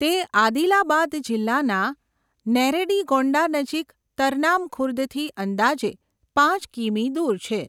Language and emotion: Gujarati, neutral